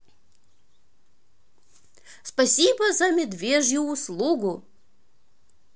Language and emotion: Russian, positive